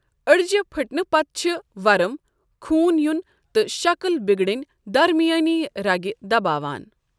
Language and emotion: Kashmiri, neutral